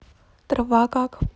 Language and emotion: Russian, neutral